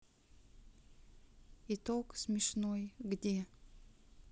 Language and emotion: Russian, sad